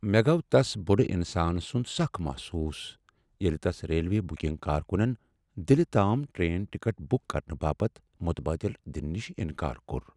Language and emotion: Kashmiri, sad